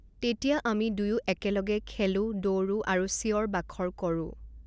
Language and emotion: Assamese, neutral